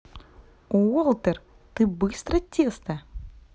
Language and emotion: Russian, positive